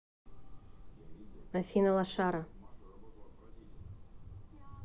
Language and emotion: Russian, angry